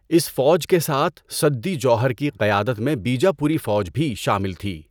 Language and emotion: Urdu, neutral